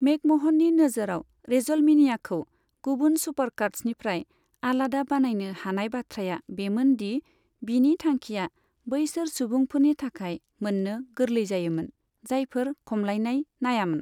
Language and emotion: Bodo, neutral